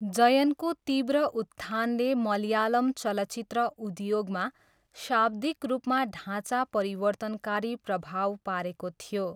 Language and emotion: Nepali, neutral